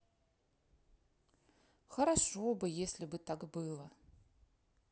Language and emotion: Russian, sad